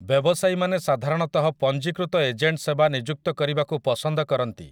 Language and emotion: Odia, neutral